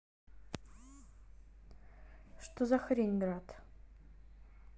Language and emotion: Russian, angry